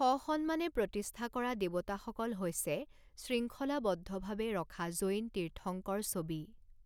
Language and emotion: Assamese, neutral